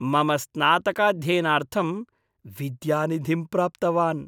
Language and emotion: Sanskrit, happy